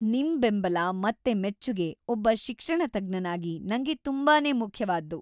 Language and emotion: Kannada, happy